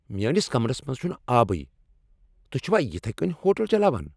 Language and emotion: Kashmiri, angry